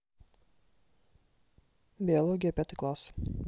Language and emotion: Russian, neutral